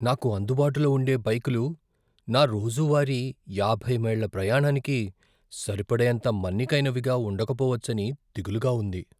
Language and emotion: Telugu, fearful